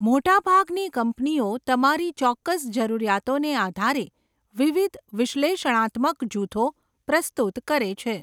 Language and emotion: Gujarati, neutral